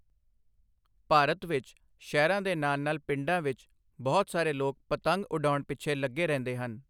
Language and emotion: Punjabi, neutral